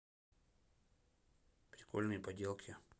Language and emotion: Russian, neutral